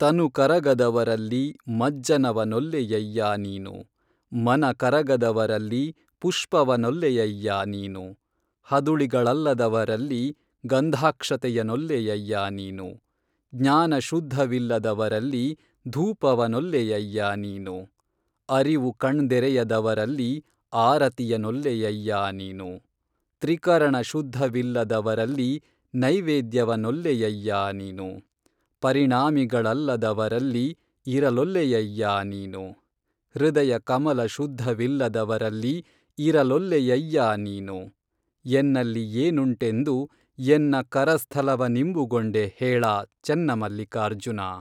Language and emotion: Kannada, neutral